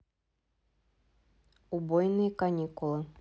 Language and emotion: Russian, neutral